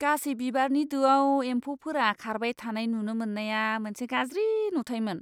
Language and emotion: Bodo, disgusted